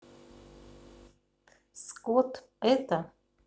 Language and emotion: Russian, neutral